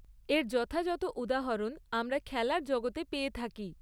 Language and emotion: Bengali, neutral